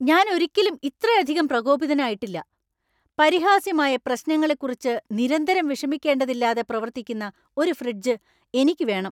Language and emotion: Malayalam, angry